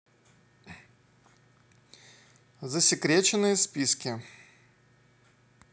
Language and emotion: Russian, neutral